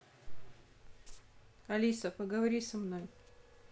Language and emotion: Russian, neutral